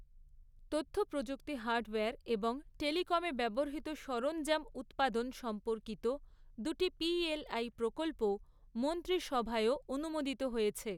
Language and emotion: Bengali, neutral